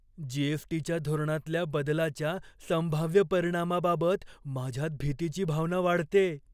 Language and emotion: Marathi, fearful